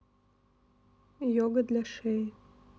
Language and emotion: Russian, neutral